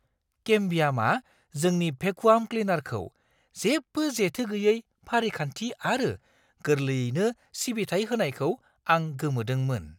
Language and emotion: Bodo, surprised